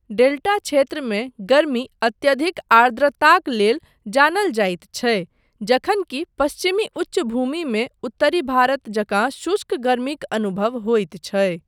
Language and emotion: Maithili, neutral